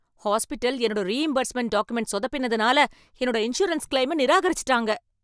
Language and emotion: Tamil, angry